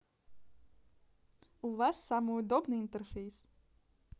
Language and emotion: Russian, positive